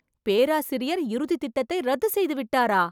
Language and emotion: Tamil, surprised